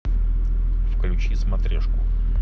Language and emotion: Russian, neutral